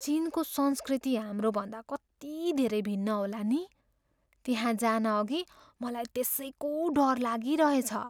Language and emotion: Nepali, fearful